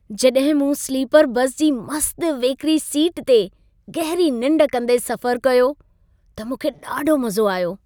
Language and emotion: Sindhi, happy